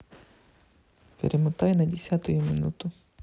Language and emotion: Russian, neutral